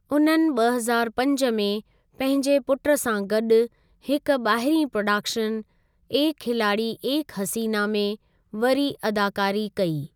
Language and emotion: Sindhi, neutral